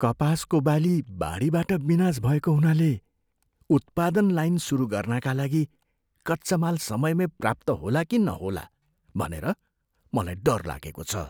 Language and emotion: Nepali, fearful